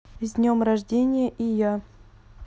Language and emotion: Russian, neutral